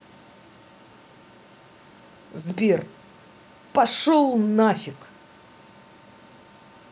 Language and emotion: Russian, angry